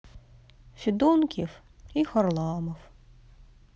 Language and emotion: Russian, sad